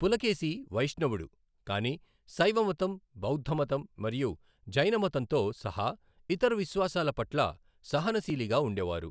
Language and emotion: Telugu, neutral